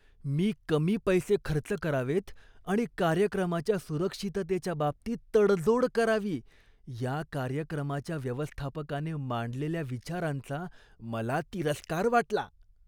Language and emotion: Marathi, disgusted